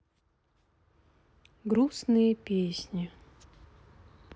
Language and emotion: Russian, sad